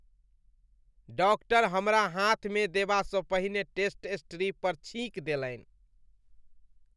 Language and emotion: Maithili, disgusted